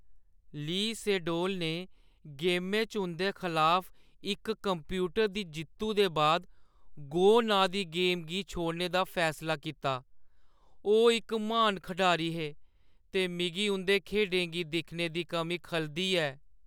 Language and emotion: Dogri, sad